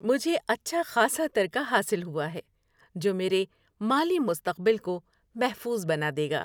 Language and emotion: Urdu, happy